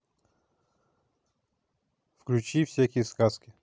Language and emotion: Russian, neutral